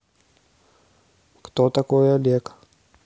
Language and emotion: Russian, neutral